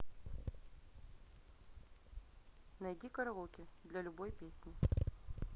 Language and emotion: Russian, neutral